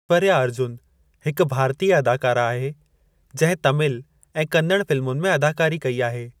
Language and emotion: Sindhi, neutral